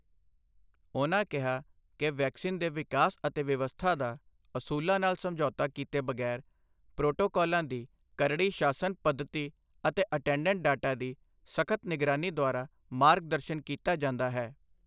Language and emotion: Punjabi, neutral